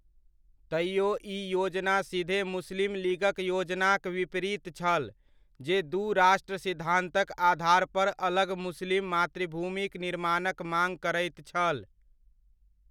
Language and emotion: Maithili, neutral